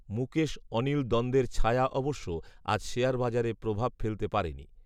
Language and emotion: Bengali, neutral